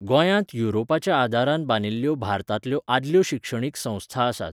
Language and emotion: Goan Konkani, neutral